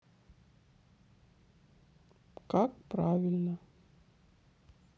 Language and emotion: Russian, sad